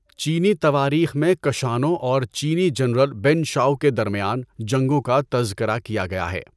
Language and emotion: Urdu, neutral